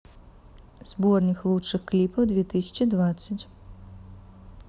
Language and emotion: Russian, neutral